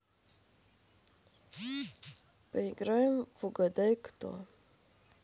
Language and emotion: Russian, neutral